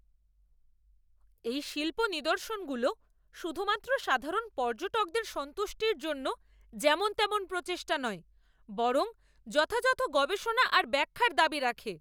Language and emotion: Bengali, angry